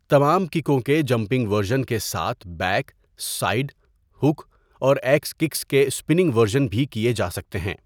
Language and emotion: Urdu, neutral